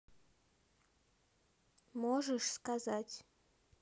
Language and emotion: Russian, neutral